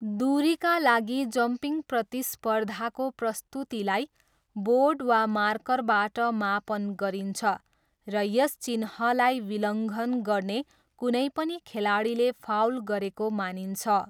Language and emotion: Nepali, neutral